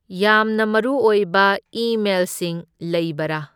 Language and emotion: Manipuri, neutral